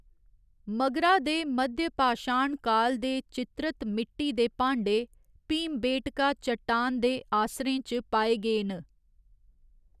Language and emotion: Dogri, neutral